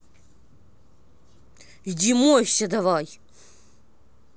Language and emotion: Russian, angry